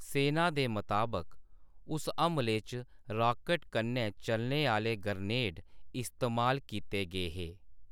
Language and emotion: Dogri, neutral